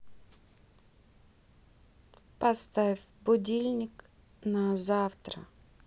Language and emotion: Russian, neutral